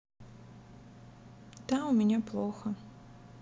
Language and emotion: Russian, sad